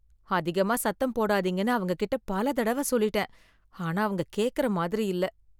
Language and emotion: Tamil, sad